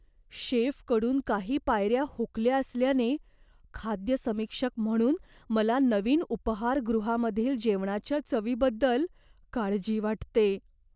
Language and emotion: Marathi, fearful